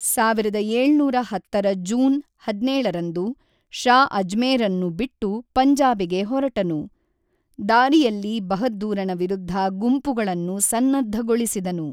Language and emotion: Kannada, neutral